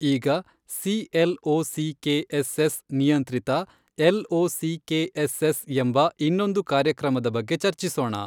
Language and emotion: Kannada, neutral